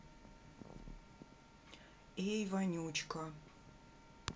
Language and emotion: Russian, neutral